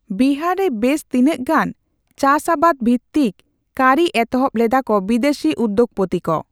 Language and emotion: Santali, neutral